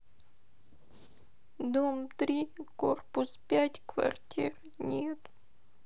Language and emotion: Russian, sad